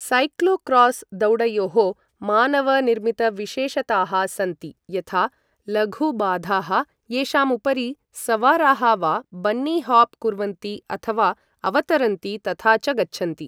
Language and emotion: Sanskrit, neutral